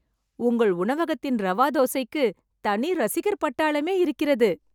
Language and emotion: Tamil, happy